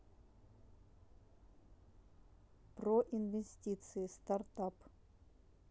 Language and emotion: Russian, neutral